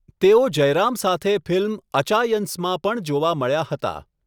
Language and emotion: Gujarati, neutral